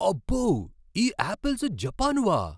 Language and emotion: Telugu, surprised